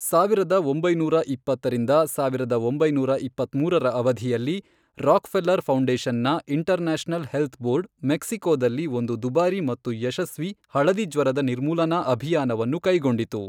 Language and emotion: Kannada, neutral